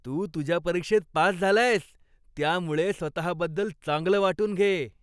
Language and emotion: Marathi, happy